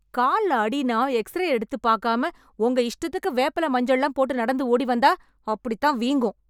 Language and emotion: Tamil, angry